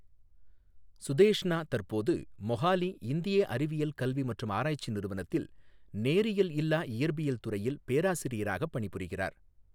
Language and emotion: Tamil, neutral